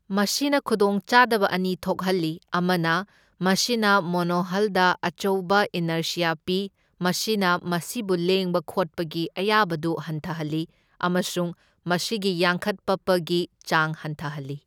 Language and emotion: Manipuri, neutral